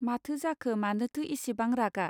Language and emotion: Bodo, neutral